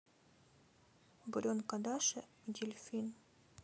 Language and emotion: Russian, sad